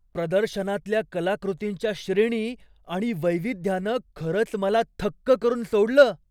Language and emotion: Marathi, surprised